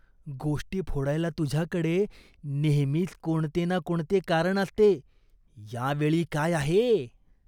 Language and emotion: Marathi, disgusted